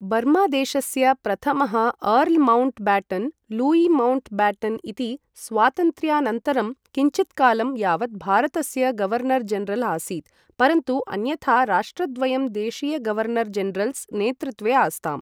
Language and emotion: Sanskrit, neutral